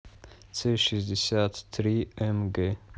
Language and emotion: Russian, neutral